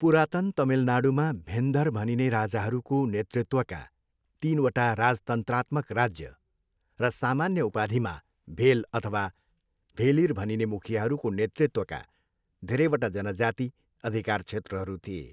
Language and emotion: Nepali, neutral